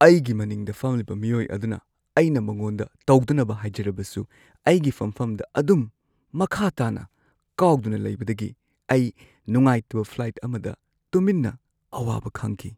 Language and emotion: Manipuri, sad